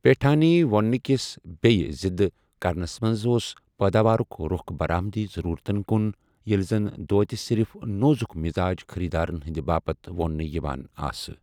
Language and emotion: Kashmiri, neutral